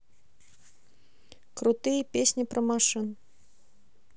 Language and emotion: Russian, neutral